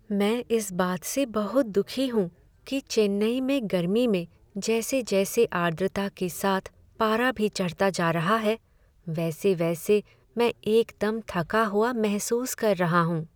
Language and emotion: Hindi, sad